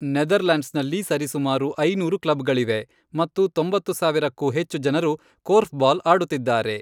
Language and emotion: Kannada, neutral